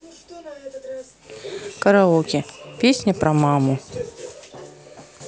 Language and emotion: Russian, neutral